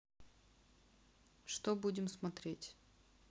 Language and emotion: Russian, neutral